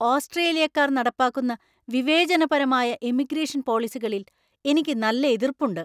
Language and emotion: Malayalam, angry